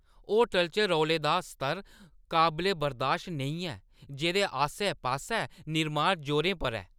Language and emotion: Dogri, angry